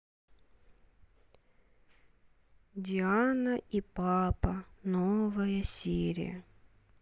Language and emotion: Russian, sad